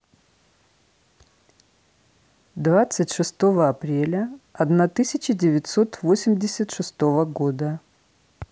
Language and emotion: Russian, neutral